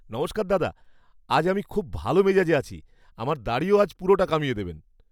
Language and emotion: Bengali, happy